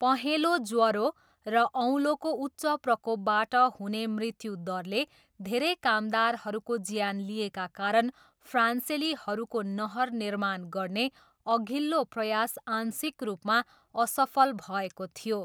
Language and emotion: Nepali, neutral